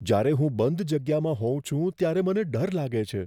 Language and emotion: Gujarati, fearful